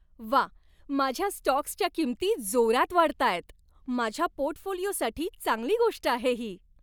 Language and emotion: Marathi, happy